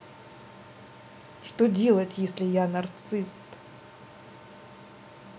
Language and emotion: Russian, neutral